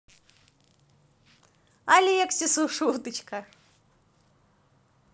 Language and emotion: Russian, positive